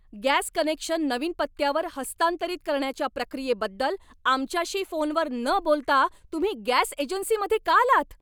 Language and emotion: Marathi, angry